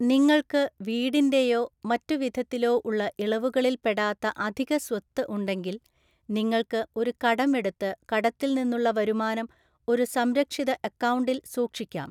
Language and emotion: Malayalam, neutral